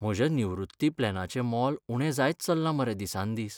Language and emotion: Goan Konkani, sad